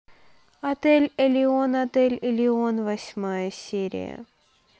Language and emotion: Russian, neutral